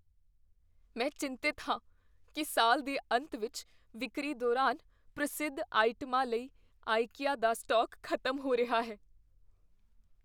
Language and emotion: Punjabi, fearful